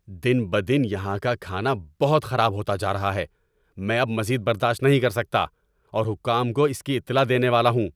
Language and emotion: Urdu, angry